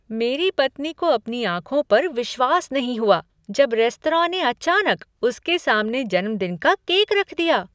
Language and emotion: Hindi, surprised